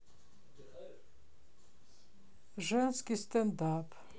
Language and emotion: Russian, sad